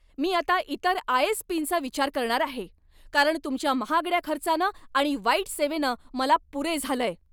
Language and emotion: Marathi, angry